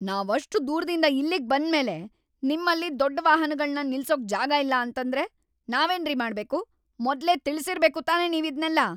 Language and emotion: Kannada, angry